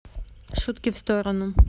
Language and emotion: Russian, neutral